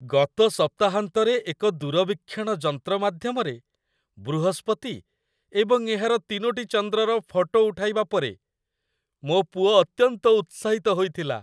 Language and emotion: Odia, happy